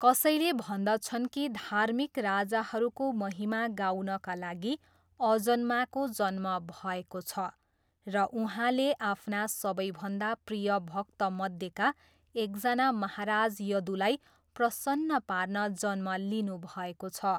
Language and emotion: Nepali, neutral